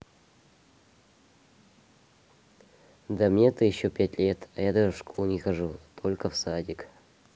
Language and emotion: Russian, sad